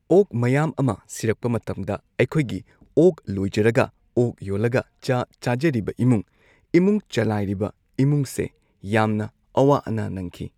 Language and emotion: Manipuri, neutral